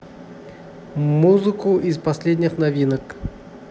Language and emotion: Russian, neutral